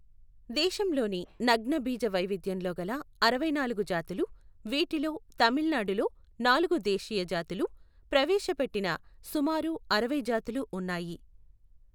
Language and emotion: Telugu, neutral